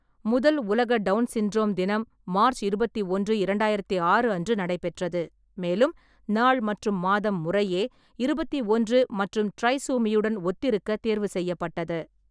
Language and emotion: Tamil, neutral